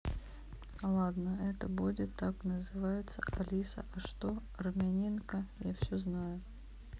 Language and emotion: Russian, neutral